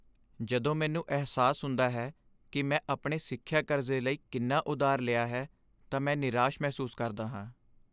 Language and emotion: Punjabi, sad